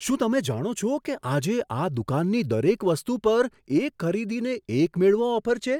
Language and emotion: Gujarati, surprised